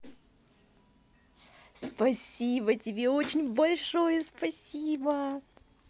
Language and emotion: Russian, positive